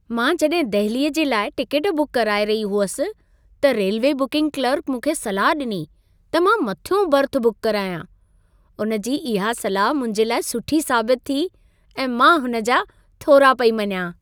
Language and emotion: Sindhi, happy